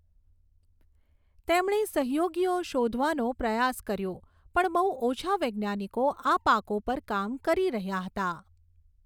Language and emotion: Gujarati, neutral